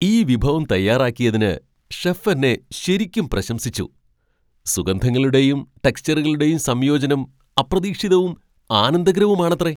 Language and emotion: Malayalam, surprised